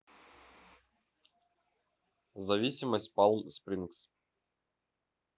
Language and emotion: Russian, neutral